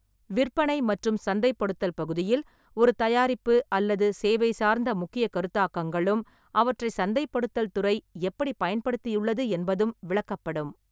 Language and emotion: Tamil, neutral